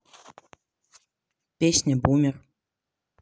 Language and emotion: Russian, neutral